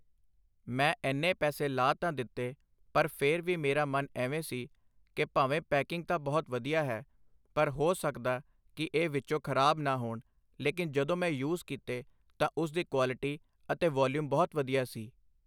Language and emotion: Punjabi, neutral